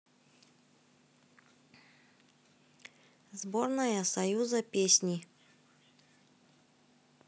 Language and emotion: Russian, neutral